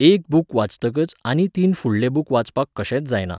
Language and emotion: Goan Konkani, neutral